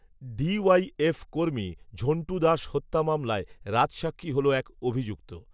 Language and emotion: Bengali, neutral